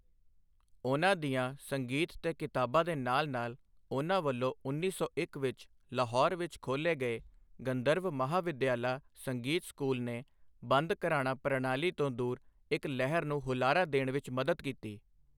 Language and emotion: Punjabi, neutral